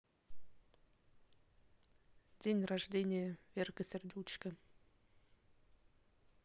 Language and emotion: Russian, neutral